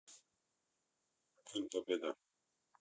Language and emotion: Russian, neutral